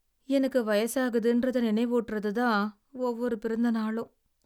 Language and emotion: Tamil, sad